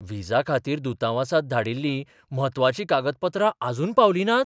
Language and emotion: Goan Konkani, surprised